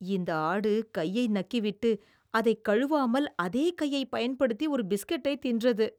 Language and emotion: Tamil, disgusted